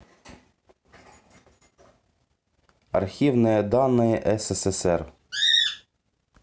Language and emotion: Russian, neutral